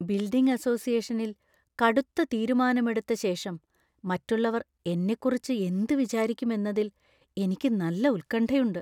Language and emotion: Malayalam, fearful